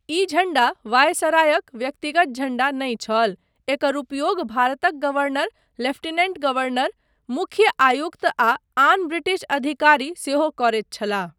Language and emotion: Maithili, neutral